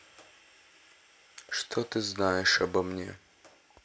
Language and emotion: Russian, sad